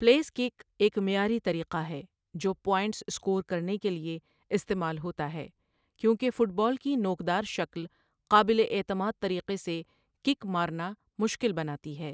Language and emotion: Urdu, neutral